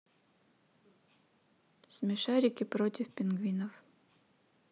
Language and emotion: Russian, neutral